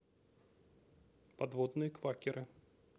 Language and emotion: Russian, neutral